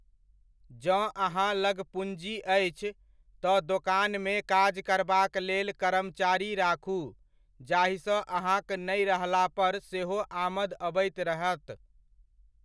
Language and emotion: Maithili, neutral